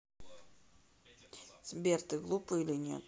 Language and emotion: Russian, neutral